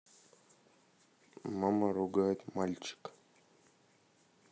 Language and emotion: Russian, neutral